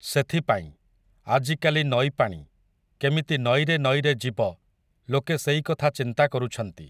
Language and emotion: Odia, neutral